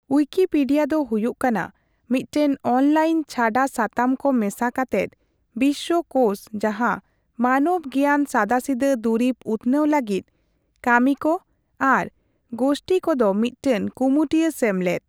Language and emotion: Santali, neutral